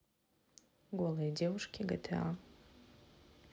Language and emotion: Russian, neutral